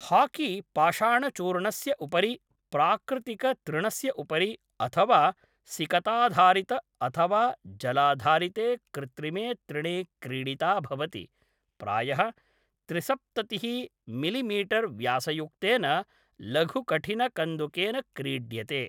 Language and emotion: Sanskrit, neutral